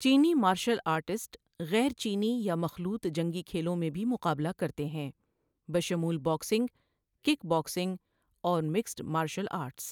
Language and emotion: Urdu, neutral